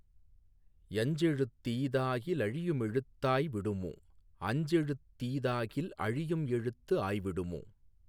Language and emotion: Tamil, neutral